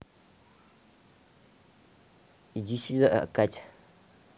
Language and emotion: Russian, neutral